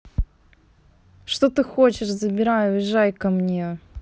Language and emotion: Russian, neutral